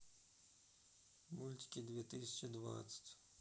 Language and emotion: Russian, sad